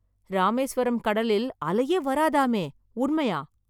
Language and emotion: Tamil, surprised